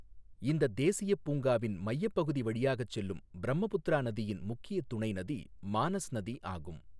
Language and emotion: Tamil, neutral